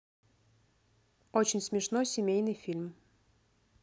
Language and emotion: Russian, neutral